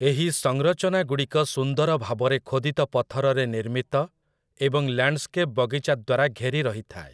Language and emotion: Odia, neutral